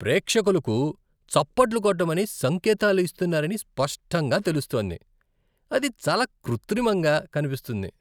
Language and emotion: Telugu, disgusted